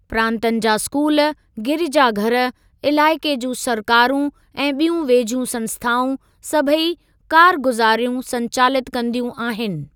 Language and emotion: Sindhi, neutral